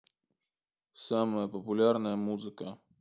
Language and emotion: Russian, neutral